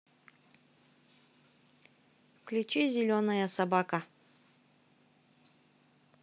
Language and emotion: Russian, positive